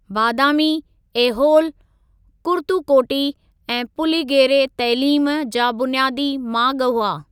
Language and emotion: Sindhi, neutral